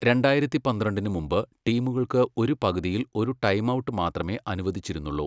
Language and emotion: Malayalam, neutral